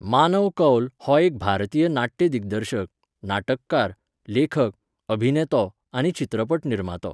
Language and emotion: Goan Konkani, neutral